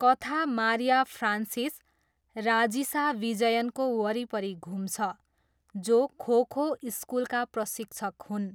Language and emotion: Nepali, neutral